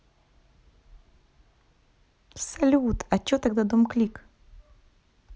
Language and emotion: Russian, positive